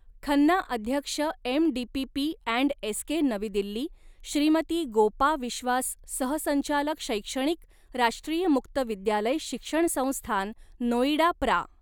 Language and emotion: Marathi, neutral